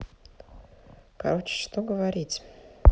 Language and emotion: Russian, sad